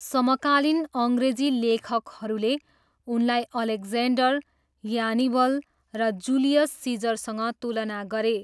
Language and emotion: Nepali, neutral